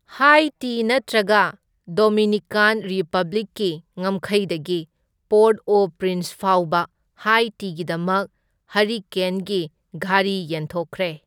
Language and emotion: Manipuri, neutral